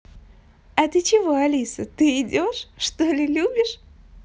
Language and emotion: Russian, positive